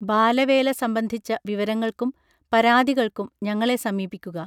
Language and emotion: Malayalam, neutral